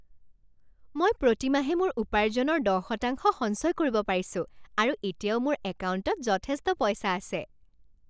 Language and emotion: Assamese, happy